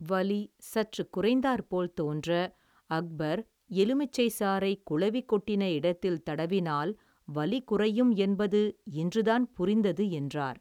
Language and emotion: Tamil, neutral